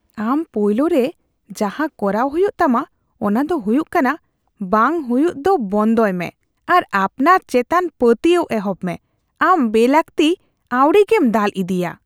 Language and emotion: Santali, disgusted